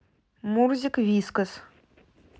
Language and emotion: Russian, neutral